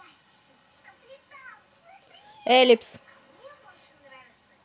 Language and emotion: Russian, neutral